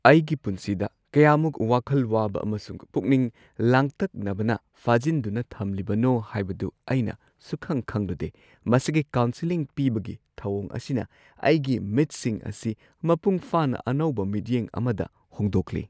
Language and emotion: Manipuri, surprised